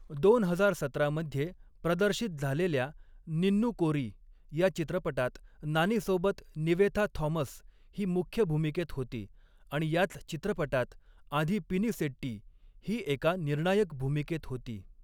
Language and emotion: Marathi, neutral